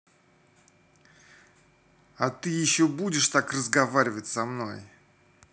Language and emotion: Russian, angry